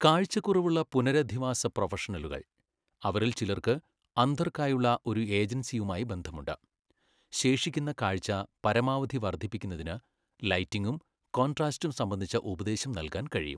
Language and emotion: Malayalam, neutral